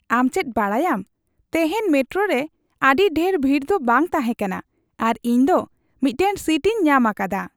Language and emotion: Santali, happy